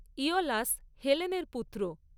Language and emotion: Bengali, neutral